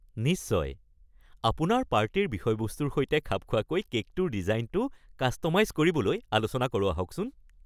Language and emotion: Assamese, happy